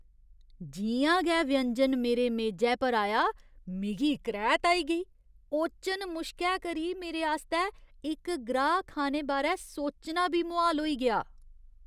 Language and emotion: Dogri, disgusted